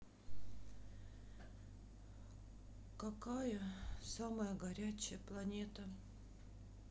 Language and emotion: Russian, sad